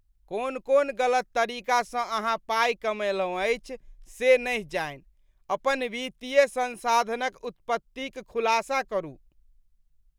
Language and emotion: Maithili, disgusted